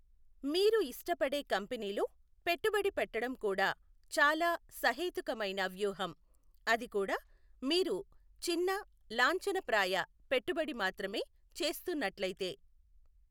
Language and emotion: Telugu, neutral